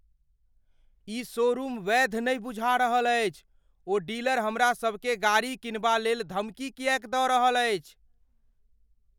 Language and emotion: Maithili, fearful